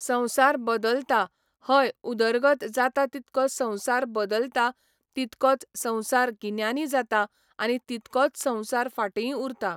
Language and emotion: Goan Konkani, neutral